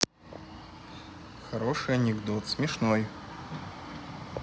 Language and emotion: Russian, neutral